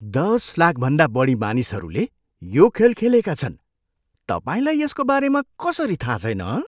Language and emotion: Nepali, surprised